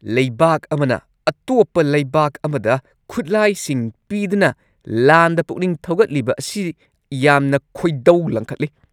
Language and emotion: Manipuri, angry